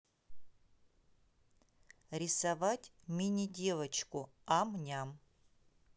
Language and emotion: Russian, neutral